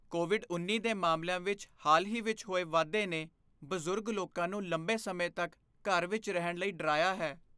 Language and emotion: Punjabi, fearful